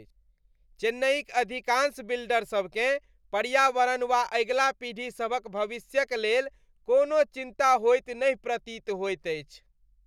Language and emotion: Maithili, disgusted